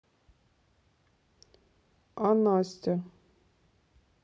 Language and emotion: Russian, neutral